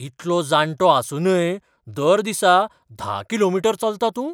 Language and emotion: Goan Konkani, surprised